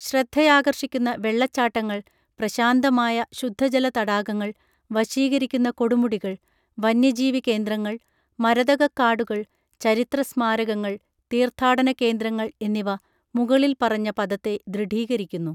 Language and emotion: Malayalam, neutral